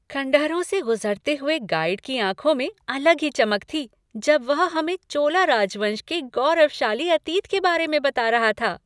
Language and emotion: Hindi, happy